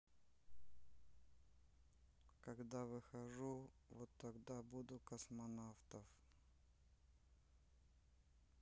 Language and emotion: Russian, sad